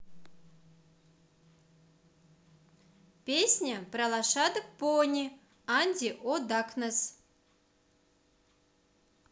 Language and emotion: Russian, positive